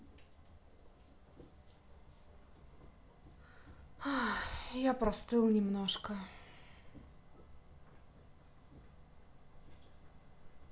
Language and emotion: Russian, sad